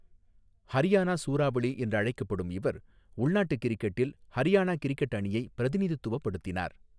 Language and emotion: Tamil, neutral